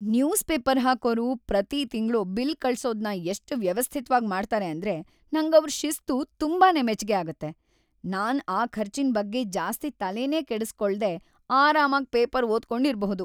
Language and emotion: Kannada, happy